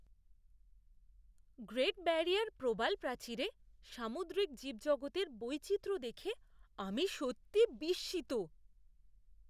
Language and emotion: Bengali, surprised